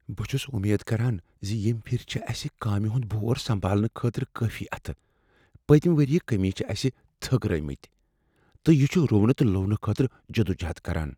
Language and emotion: Kashmiri, fearful